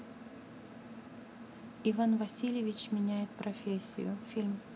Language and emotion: Russian, neutral